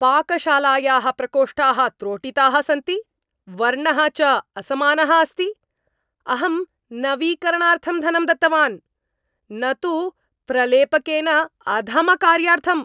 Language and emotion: Sanskrit, angry